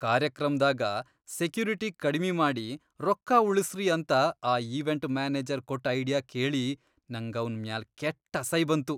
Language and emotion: Kannada, disgusted